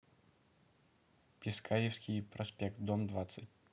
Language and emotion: Russian, neutral